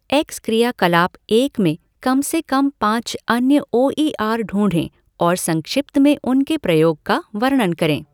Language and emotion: Hindi, neutral